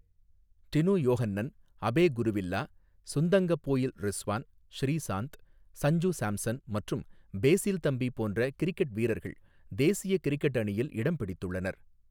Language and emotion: Tamil, neutral